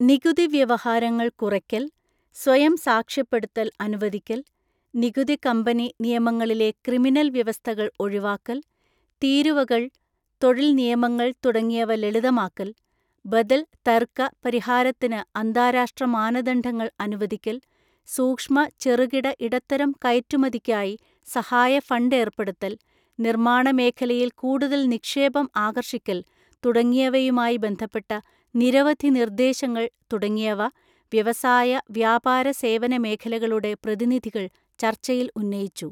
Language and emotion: Malayalam, neutral